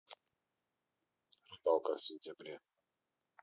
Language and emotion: Russian, neutral